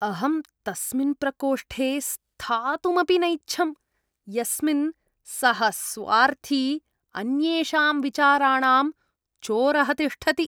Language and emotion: Sanskrit, disgusted